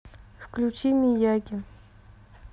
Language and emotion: Russian, neutral